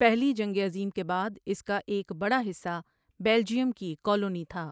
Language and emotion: Urdu, neutral